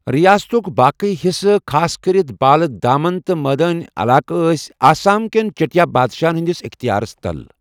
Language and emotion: Kashmiri, neutral